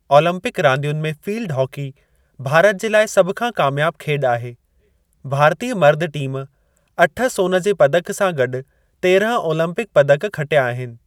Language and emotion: Sindhi, neutral